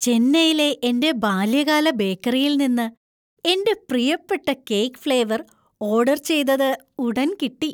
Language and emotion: Malayalam, happy